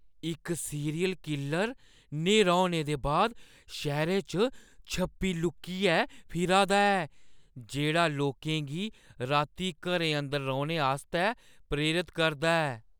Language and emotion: Dogri, fearful